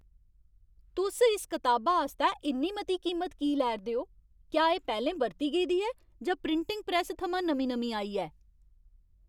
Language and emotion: Dogri, angry